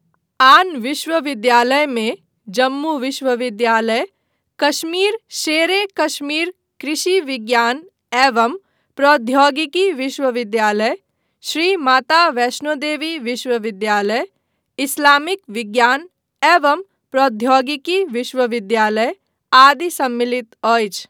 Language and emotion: Maithili, neutral